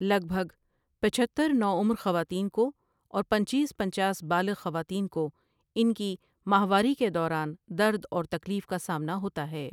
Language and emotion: Urdu, neutral